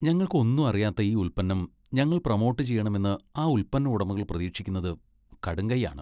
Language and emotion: Malayalam, disgusted